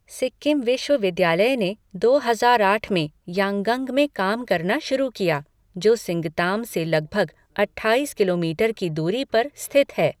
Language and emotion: Hindi, neutral